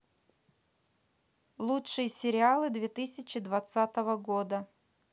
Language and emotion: Russian, neutral